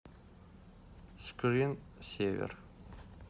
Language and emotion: Russian, neutral